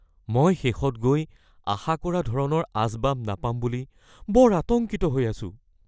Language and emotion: Assamese, fearful